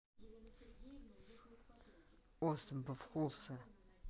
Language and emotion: Russian, neutral